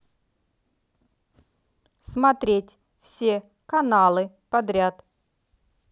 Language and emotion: Russian, neutral